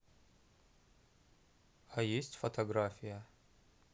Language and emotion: Russian, neutral